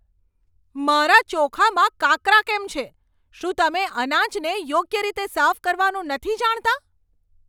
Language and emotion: Gujarati, angry